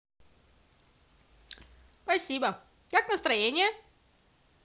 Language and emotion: Russian, positive